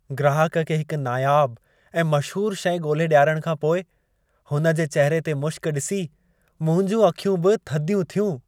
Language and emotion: Sindhi, happy